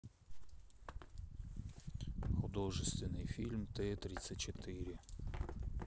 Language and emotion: Russian, neutral